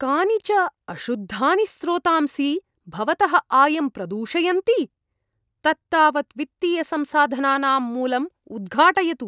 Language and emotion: Sanskrit, disgusted